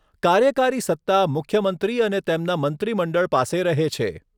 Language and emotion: Gujarati, neutral